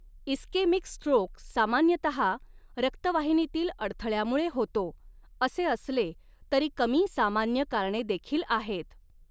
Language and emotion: Marathi, neutral